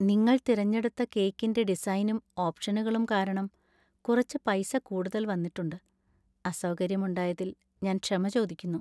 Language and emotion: Malayalam, sad